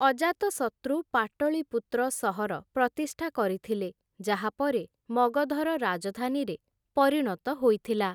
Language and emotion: Odia, neutral